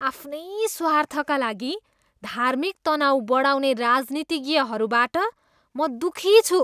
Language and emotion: Nepali, disgusted